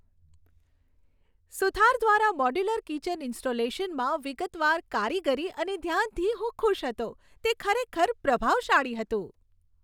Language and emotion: Gujarati, happy